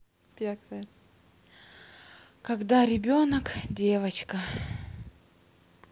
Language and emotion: Russian, sad